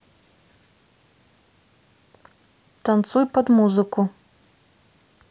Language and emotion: Russian, neutral